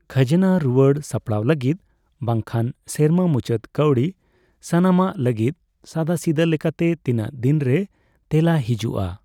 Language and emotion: Santali, neutral